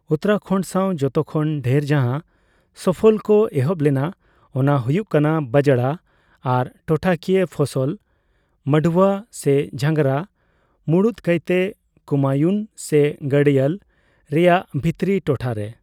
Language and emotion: Santali, neutral